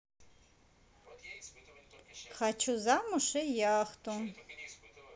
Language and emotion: Russian, positive